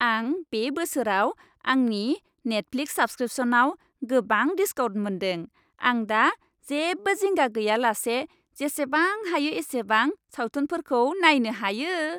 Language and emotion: Bodo, happy